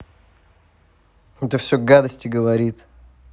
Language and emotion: Russian, angry